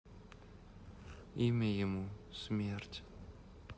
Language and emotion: Russian, sad